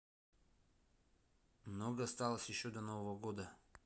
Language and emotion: Russian, neutral